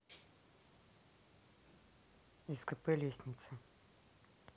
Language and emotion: Russian, neutral